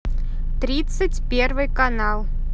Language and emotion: Russian, neutral